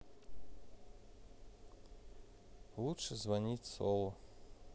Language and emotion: Russian, neutral